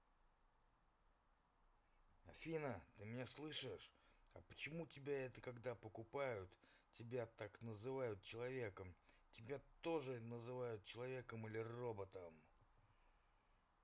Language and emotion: Russian, angry